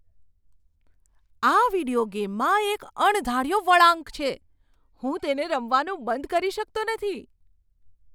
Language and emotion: Gujarati, surprised